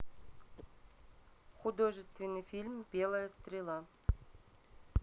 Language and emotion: Russian, neutral